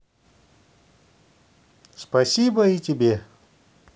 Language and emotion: Russian, positive